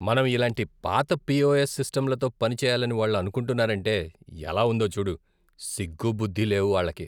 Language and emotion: Telugu, disgusted